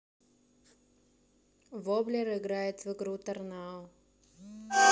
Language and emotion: Russian, neutral